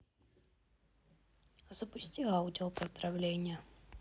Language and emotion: Russian, neutral